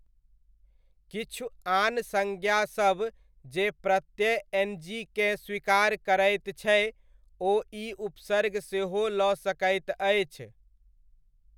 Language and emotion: Maithili, neutral